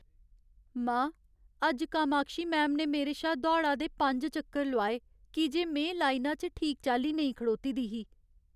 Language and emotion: Dogri, sad